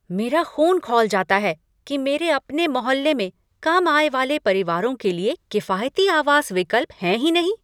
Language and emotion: Hindi, angry